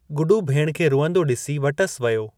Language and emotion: Sindhi, neutral